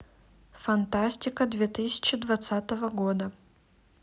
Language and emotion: Russian, neutral